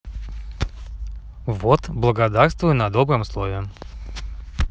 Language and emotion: Russian, positive